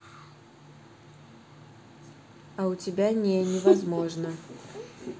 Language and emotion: Russian, neutral